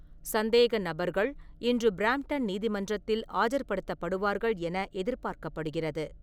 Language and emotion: Tamil, neutral